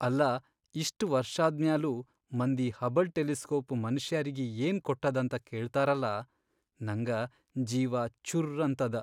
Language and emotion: Kannada, sad